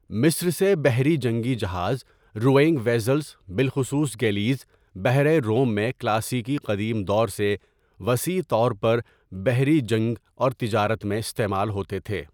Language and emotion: Urdu, neutral